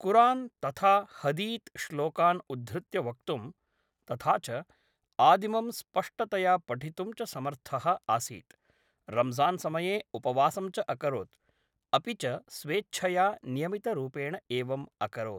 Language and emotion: Sanskrit, neutral